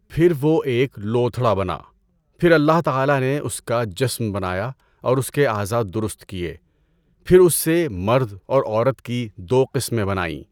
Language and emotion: Urdu, neutral